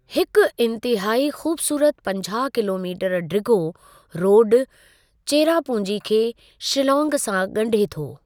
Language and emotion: Sindhi, neutral